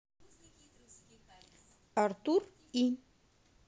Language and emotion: Russian, neutral